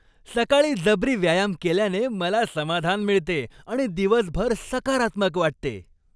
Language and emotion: Marathi, happy